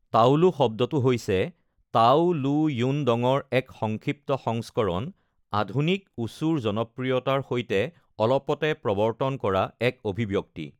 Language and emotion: Assamese, neutral